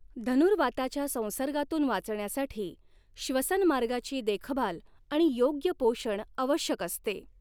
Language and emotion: Marathi, neutral